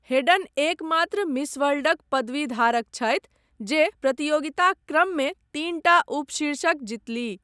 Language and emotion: Maithili, neutral